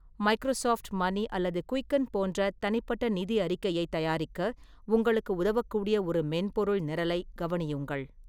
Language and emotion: Tamil, neutral